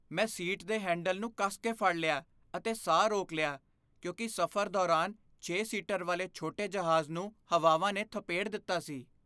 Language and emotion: Punjabi, fearful